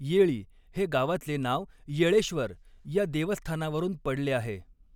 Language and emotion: Marathi, neutral